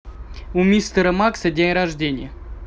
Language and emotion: Russian, neutral